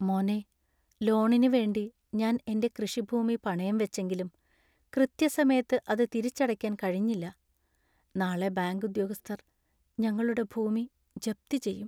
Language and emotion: Malayalam, sad